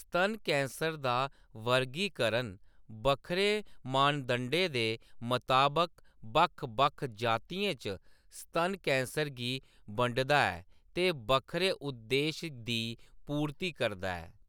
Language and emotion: Dogri, neutral